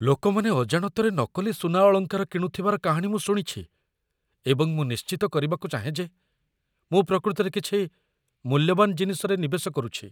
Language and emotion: Odia, fearful